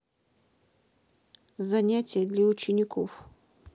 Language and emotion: Russian, neutral